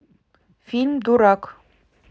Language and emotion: Russian, neutral